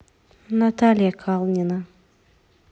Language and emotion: Russian, neutral